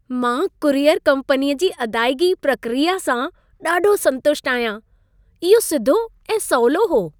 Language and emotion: Sindhi, happy